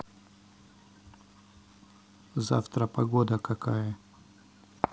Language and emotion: Russian, neutral